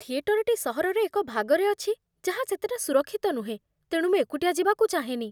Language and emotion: Odia, fearful